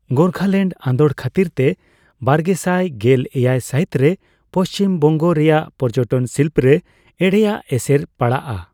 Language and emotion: Santali, neutral